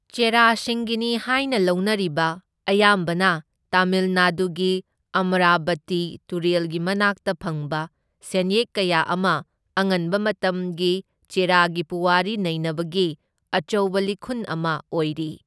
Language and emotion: Manipuri, neutral